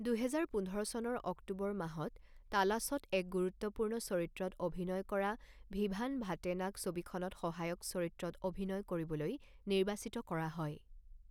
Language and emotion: Assamese, neutral